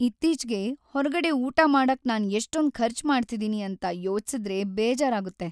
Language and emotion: Kannada, sad